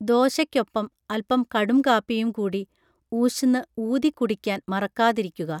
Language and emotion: Malayalam, neutral